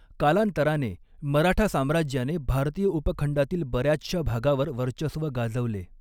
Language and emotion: Marathi, neutral